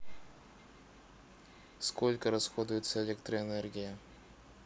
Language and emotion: Russian, neutral